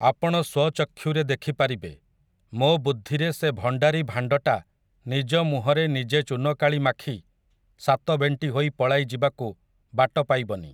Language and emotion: Odia, neutral